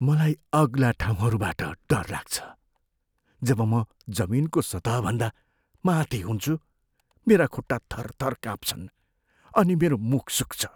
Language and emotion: Nepali, fearful